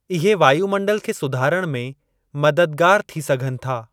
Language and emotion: Sindhi, neutral